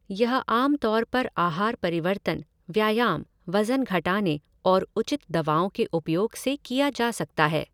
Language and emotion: Hindi, neutral